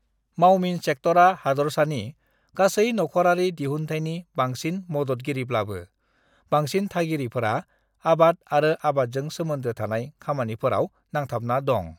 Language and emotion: Bodo, neutral